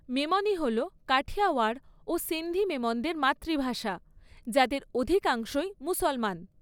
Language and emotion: Bengali, neutral